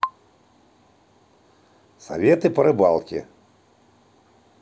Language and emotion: Russian, positive